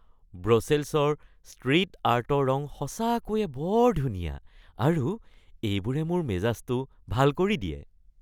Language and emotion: Assamese, happy